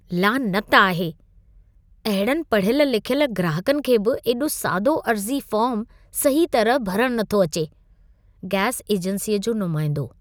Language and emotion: Sindhi, disgusted